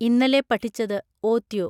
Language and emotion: Malayalam, neutral